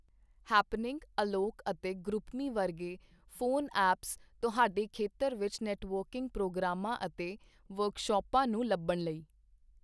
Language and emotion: Punjabi, neutral